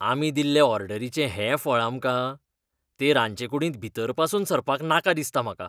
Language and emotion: Goan Konkani, disgusted